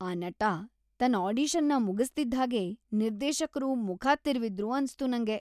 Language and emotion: Kannada, disgusted